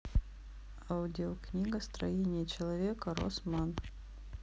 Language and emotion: Russian, neutral